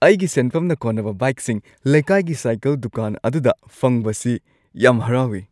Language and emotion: Manipuri, happy